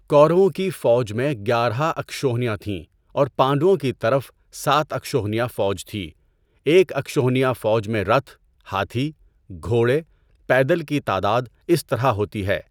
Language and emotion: Urdu, neutral